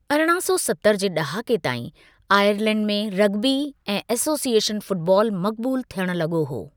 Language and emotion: Sindhi, neutral